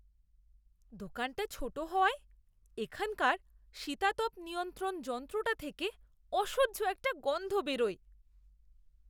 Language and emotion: Bengali, disgusted